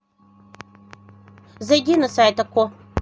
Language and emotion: Russian, neutral